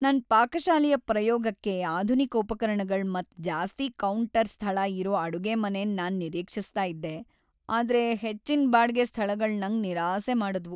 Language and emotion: Kannada, sad